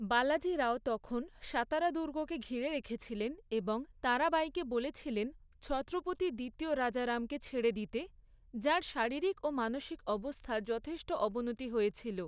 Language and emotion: Bengali, neutral